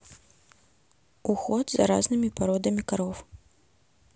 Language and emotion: Russian, neutral